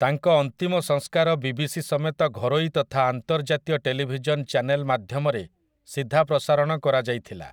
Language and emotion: Odia, neutral